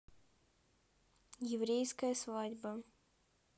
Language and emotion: Russian, neutral